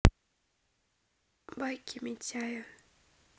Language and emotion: Russian, neutral